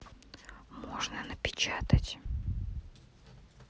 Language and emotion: Russian, neutral